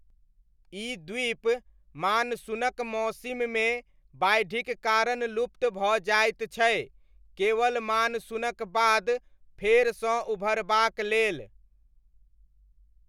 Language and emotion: Maithili, neutral